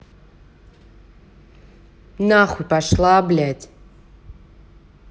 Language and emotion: Russian, angry